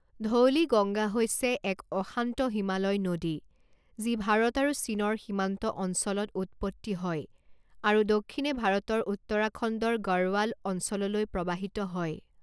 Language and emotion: Assamese, neutral